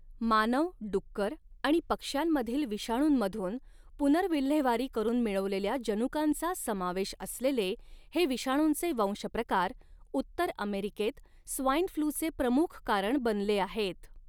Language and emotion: Marathi, neutral